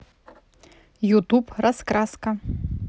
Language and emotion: Russian, neutral